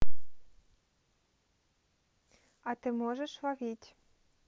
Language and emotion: Russian, neutral